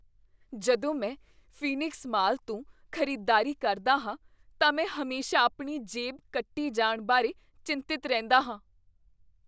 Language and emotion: Punjabi, fearful